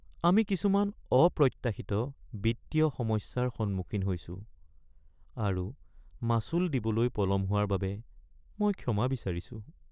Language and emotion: Assamese, sad